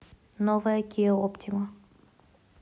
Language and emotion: Russian, neutral